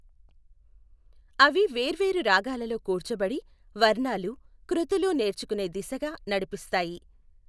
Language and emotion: Telugu, neutral